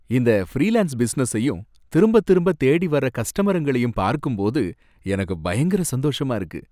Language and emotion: Tamil, happy